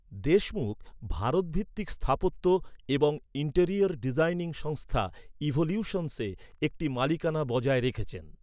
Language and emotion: Bengali, neutral